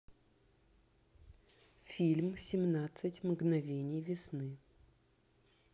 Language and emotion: Russian, neutral